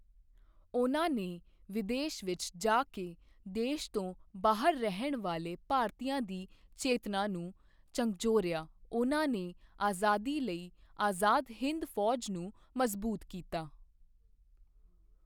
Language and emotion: Punjabi, neutral